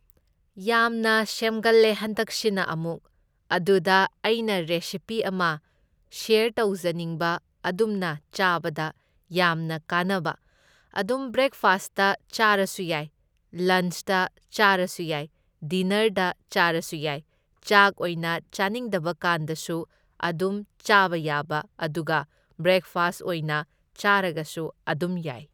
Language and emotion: Manipuri, neutral